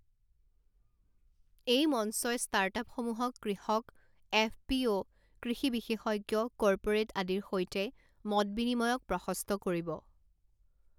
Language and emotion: Assamese, neutral